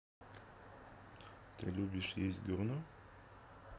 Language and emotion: Russian, neutral